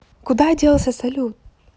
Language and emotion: Russian, positive